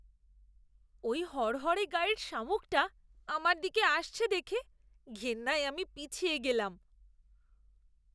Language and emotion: Bengali, disgusted